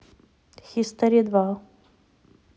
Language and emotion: Russian, neutral